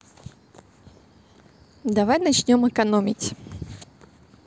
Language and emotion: Russian, positive